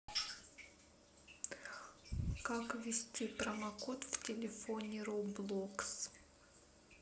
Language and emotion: Russian, neutral